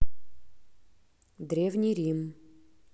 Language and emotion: Russian, neutral